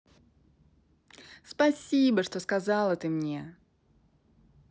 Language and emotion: Russian, positive